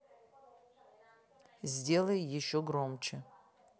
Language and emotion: Russian, neutral